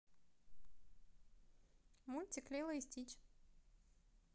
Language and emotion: Russian, positive